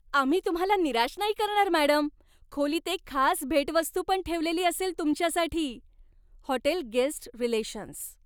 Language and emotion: Marathi, happy